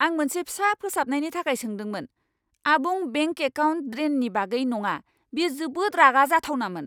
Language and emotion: Bodo, angry